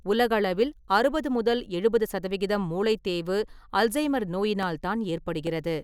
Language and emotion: Tamil, neutral